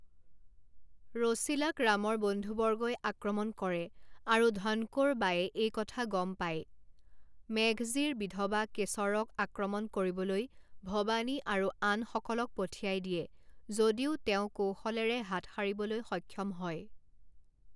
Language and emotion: Assamese, neutral